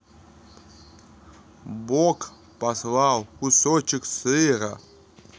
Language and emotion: Russian, neutral